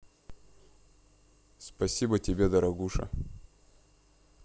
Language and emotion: Russian, neutral